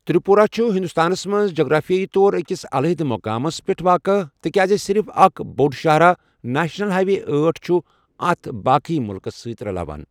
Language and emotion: Kashmiri, neutral